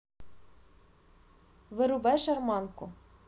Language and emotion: Russian, neutral